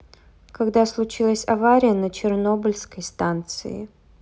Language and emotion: Russian, neutral